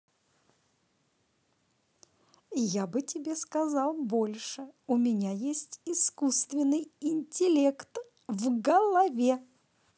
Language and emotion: Russian, positive